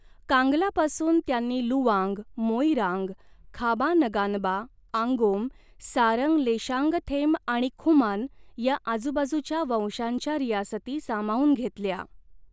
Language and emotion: Marathi, neutral